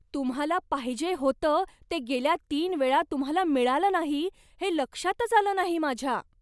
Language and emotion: Marathi, surprised